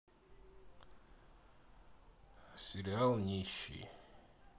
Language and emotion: Russian, neutral